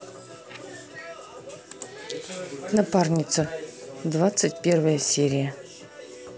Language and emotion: Russian, neutral